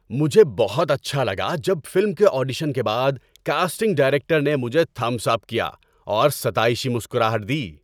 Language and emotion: Urdu, happy